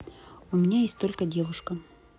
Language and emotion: Russian, neutral